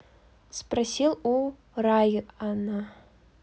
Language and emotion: Russian, neutral